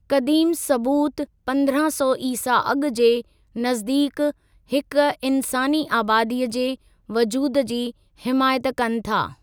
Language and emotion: Sindhi, neutral